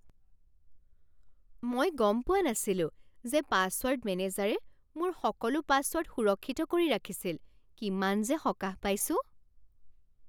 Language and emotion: Assamese, surprised